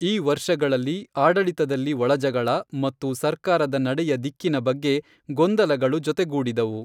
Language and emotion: Kannada, neutral